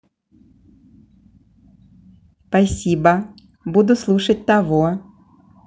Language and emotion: Russian, positive